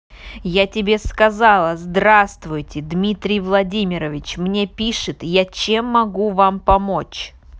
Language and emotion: Russian, angry